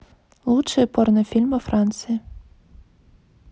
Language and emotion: Russian, neutral